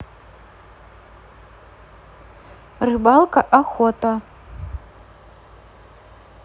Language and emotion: Russian, neutral